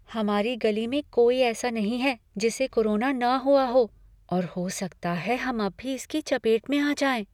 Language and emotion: Hindi, fearful